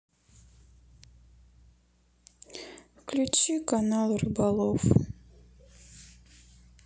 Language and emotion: Russian, sad